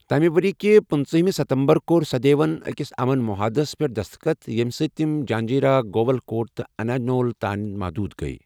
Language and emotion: Kashmiri, neutral